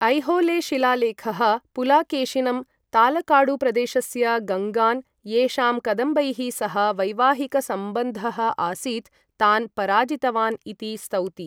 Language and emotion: Sanskrit, neutral